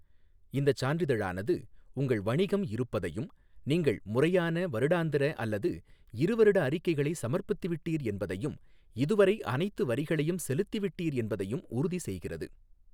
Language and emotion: Tamil, neutral